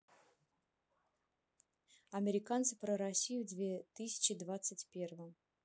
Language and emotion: Russian, neutral